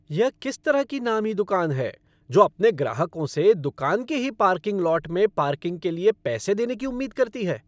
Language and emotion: Hindi, angry